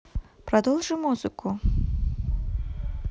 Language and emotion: Russian, neutral